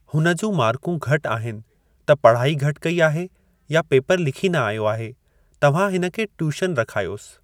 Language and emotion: Sindhi, neutral